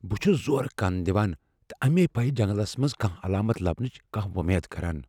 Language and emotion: Kashmiri, fearful